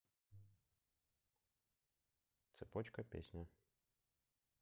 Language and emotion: Russian, neutral